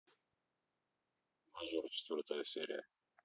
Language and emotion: Russian, neutral